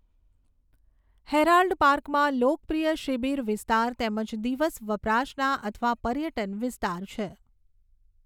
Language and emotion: Gujarati, neutral